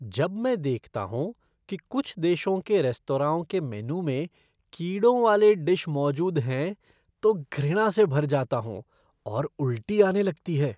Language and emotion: Hindi, disgusted